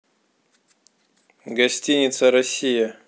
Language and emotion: Russian, neutral